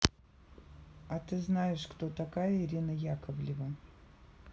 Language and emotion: Russian, neutral